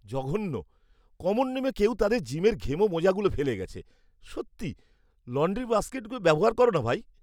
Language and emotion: Bengali, disgusted